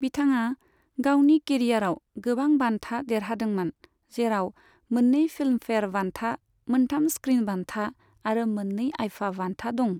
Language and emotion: Bodo, neutral